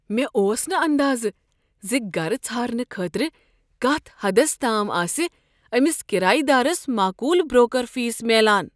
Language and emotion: Kashmiri, surprised